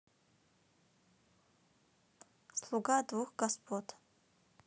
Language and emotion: Russian, neutral